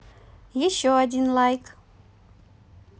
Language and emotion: Russian, positive